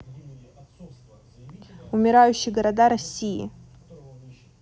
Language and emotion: Russian, neutral